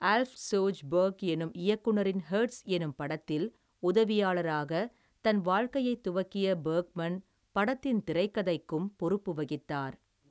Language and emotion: Tamil, neutral